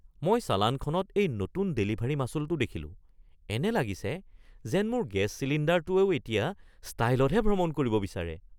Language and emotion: Assamese, surprised